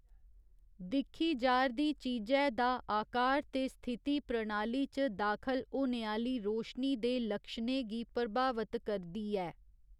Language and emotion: Dogri, neutral